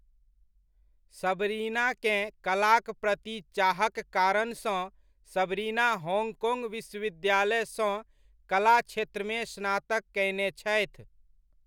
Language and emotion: Maithili, neutral